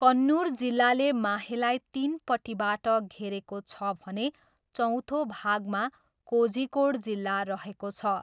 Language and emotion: Nepali, neutral